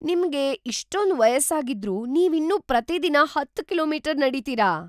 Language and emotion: Kannada, surprised